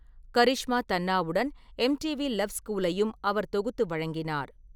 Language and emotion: Tamil, neutral